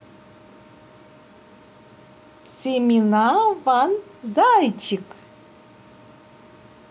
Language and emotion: Russian, positive